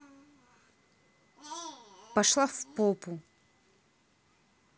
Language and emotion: Russian, angry